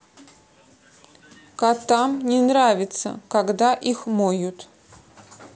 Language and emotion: Russian, neutral